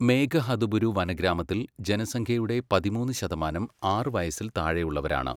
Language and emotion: Malayalam, neutral